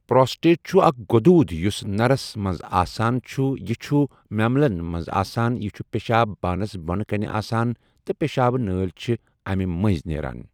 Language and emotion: Kashmiri, neutral